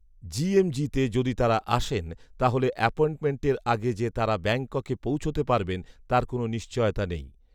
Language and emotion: Bengali, neutral